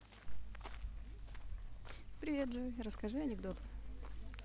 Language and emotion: Russian, positive